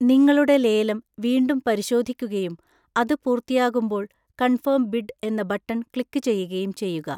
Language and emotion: Malayalam, neutral